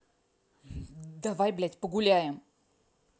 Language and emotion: Russian, angry